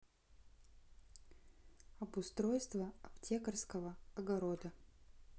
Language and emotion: Russian, neutral